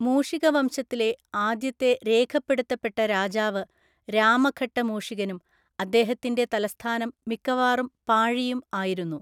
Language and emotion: Malayalam, neutral